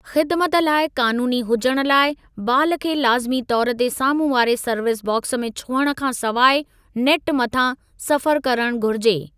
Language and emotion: Sindhi, neutral